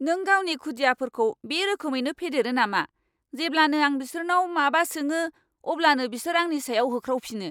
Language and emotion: Bodo, angry